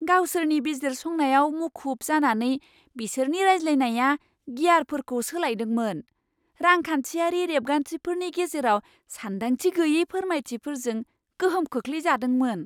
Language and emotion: Bodo, surprised